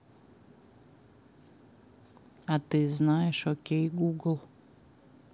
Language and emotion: Russian, neutral